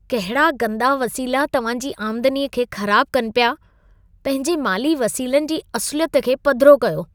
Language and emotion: Sindhi, disgusted